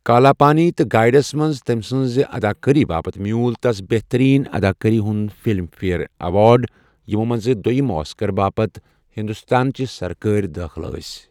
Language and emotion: Kashmiri, neutral